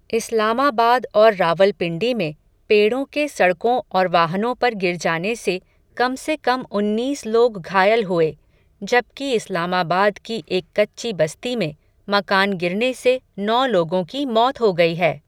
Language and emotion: Hindi, neutral